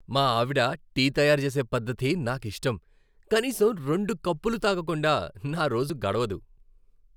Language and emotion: Telugu, happy